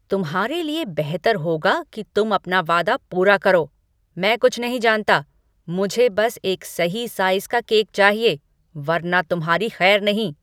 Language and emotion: Hindi, angry